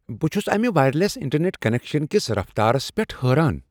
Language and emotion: Kashmiri, surprised